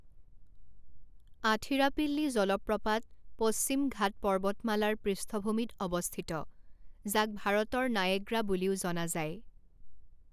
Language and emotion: Assamese, neutral